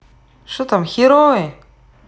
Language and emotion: Russian, neutral